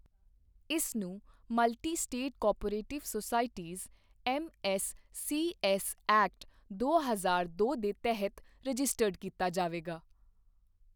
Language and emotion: Punjabi, neutral